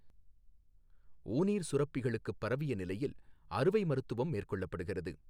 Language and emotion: Tamil, neutral